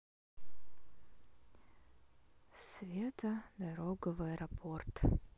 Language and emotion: Russian, sad